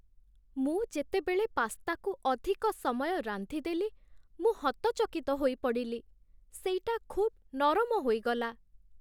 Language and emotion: Odia, sad